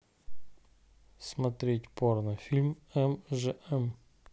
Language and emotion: Russian, neutral